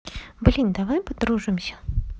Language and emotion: Russian, positive